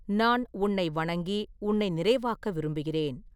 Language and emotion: Tamil, neutral